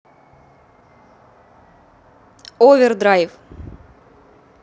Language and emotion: Russian, neutral